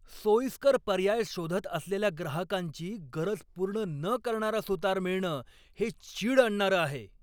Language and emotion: Marathi, angry